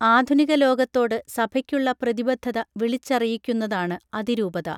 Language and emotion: Malayalam, neutral